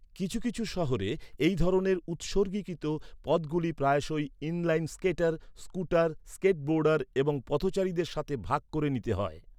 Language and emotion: Bengali, neutral